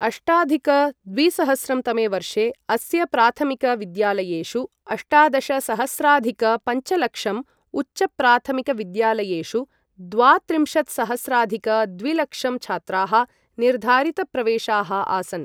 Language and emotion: Sanskrit, neutral